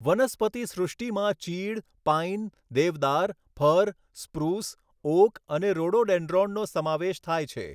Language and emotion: Gujarati, neutral